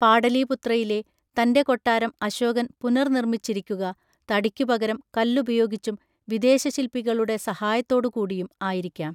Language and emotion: Malayalam, neutral